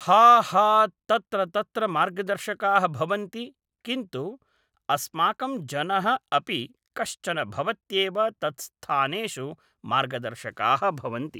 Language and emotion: Sanskrit, neutral